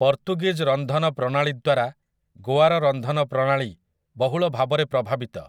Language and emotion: Odia, neutral